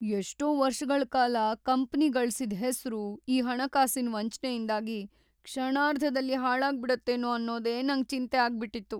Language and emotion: Kannada, fearful